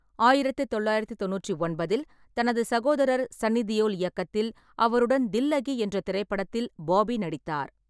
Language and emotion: Tamil, neutral